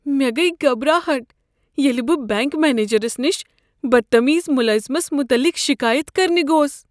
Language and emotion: Kashmiri, fearful